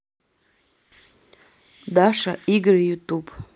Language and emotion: Russian, neutral